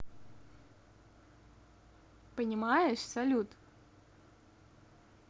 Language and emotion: Russian, positive